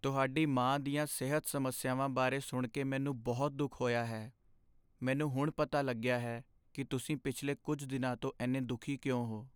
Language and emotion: Punjabi, sad